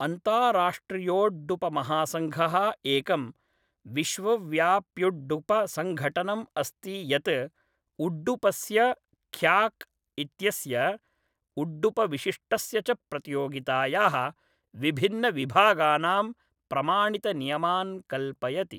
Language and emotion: Sanskrit, neutral